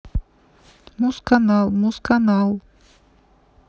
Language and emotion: Russian, neutral